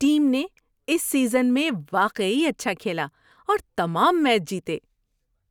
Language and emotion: Urdu, happy